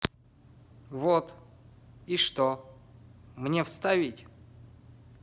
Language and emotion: Russian, neutral